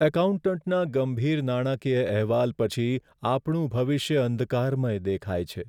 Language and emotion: Gujarati, sad